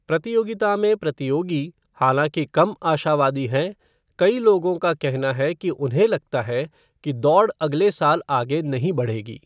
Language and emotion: Hindi, neutral